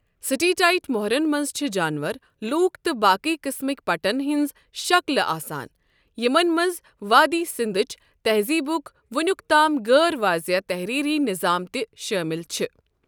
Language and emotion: Kashmiri, neutral